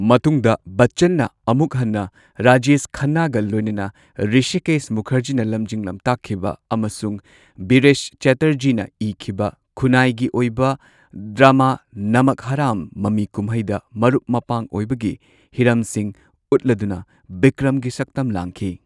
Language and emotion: Manipuri, neutral